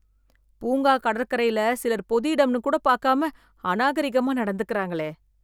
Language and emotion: Tamil, disgusted